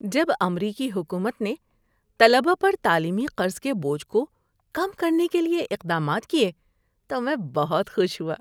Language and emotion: Urdu, happy